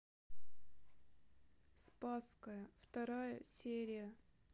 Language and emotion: Russian, sad